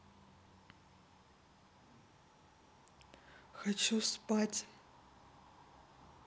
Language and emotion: Russian, neutral